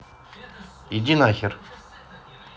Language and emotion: Russian, angry